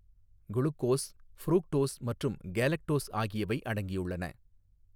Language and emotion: Tamil, neutral